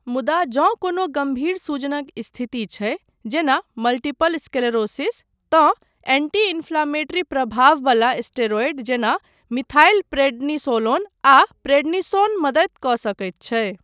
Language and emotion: Maithili, neutral